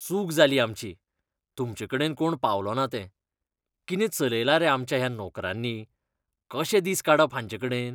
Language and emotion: Goan Konkani, disgusted